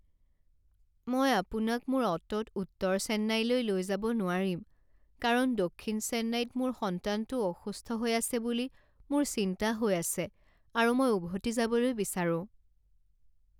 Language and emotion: Assamese, sad